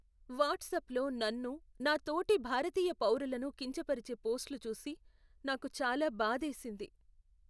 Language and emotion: Telugu, sad